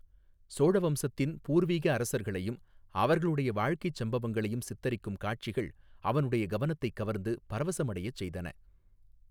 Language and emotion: Tamil, neutral